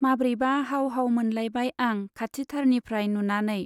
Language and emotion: Bodo, neutral